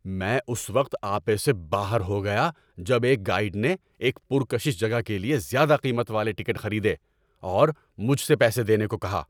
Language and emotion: Urdu, angry